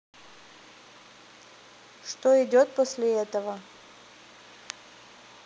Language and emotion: Russian, neutral